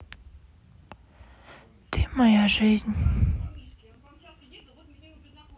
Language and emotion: Russian, sad